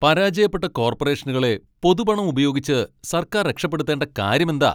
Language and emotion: Malayalam, angry